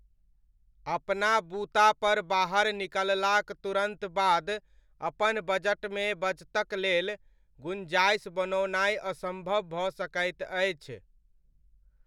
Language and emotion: Maithili, neutral